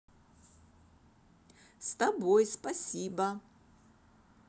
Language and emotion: Russian, positive